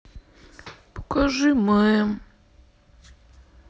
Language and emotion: Russian, sad